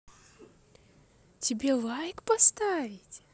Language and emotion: Russian, positive